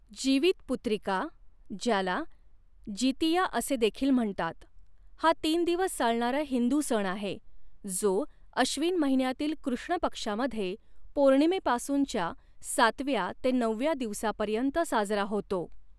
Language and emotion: Marathi, neutral